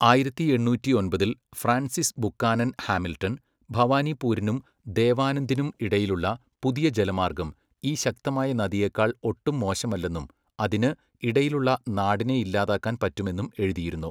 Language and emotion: Malayalam, neutral